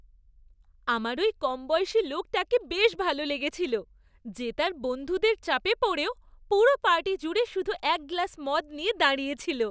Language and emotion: Bengali, happy